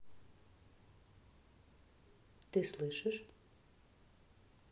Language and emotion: Russian, neutral